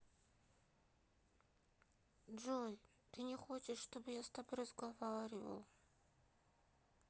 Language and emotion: Russian, sad